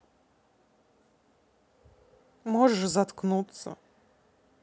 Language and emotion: Russian, neutral